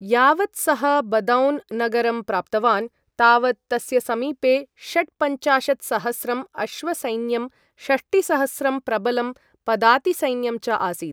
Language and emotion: Sanskrit, neutral